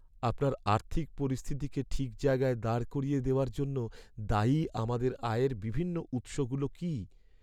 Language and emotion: Bengali, sad